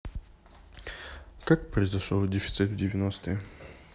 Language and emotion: Russian, neutral